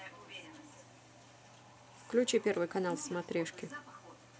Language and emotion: Russian, neutral